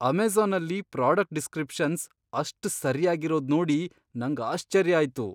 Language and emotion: Kannada, surprised